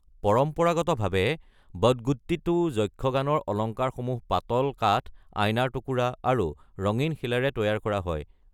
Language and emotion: Assamese, neutral